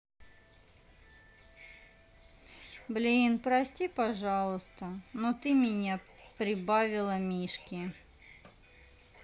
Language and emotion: Russian, sad